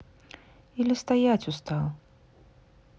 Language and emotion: Russian, sad